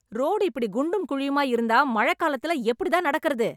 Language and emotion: Tamil, angry